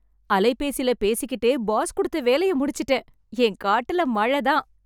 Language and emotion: Tamil, happy